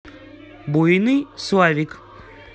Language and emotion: Russian, positive